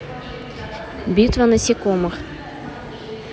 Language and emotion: Russian, neutral